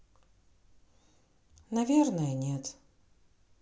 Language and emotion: Russian, sad